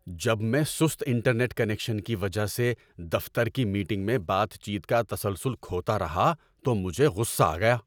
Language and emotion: Urdu, angry